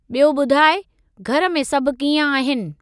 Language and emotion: Sindhi, neutral